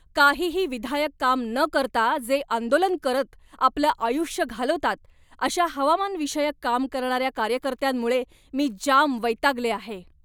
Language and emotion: Marathi, angry